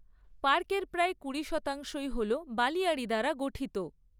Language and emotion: Bengali, neutral